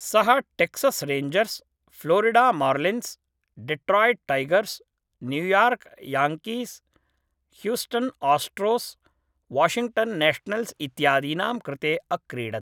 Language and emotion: Sanskrit, neutral